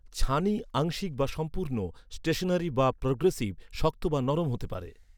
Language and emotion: Bengali, neutral